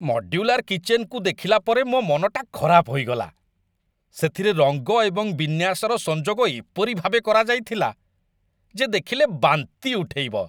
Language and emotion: Odia, disgusted